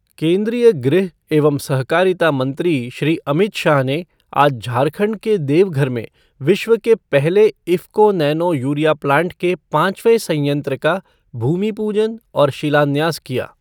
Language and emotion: Hindi, neutral